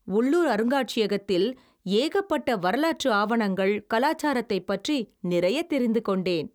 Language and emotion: Tamil, happy